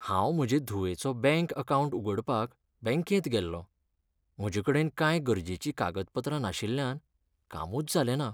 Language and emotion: Goan Konkani, sad